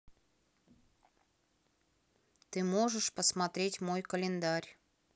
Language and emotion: Russian, neutral